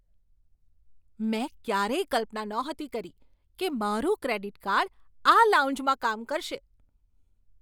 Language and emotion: Gujarati, surprised